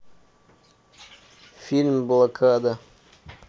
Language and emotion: Russian, neutral